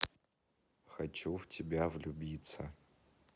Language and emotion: Russian, neutral